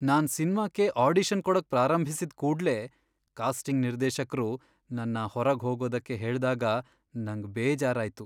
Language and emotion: Kannada, sad